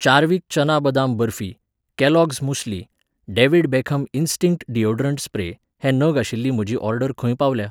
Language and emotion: Goan Konkani, neutral